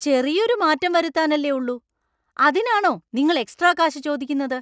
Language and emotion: Malayalam, angry